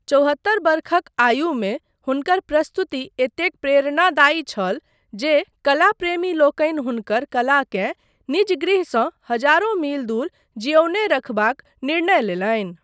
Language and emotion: Maithili, neutral